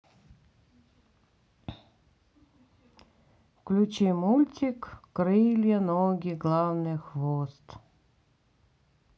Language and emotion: Russian, sad